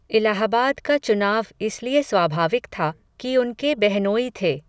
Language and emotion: Hindi, neutral